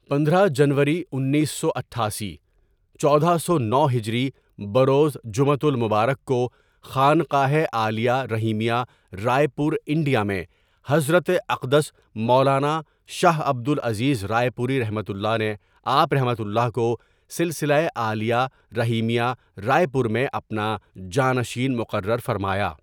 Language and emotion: Urdu, neutral